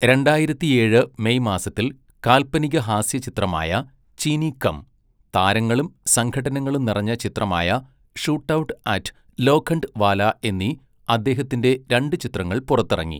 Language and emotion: Malayalam, neutral